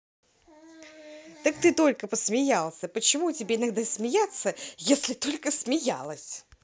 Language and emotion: Russian, positive